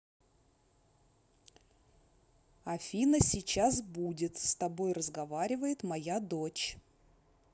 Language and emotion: Russian, neutral